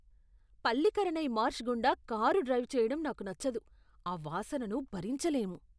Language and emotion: Telugu, disgusted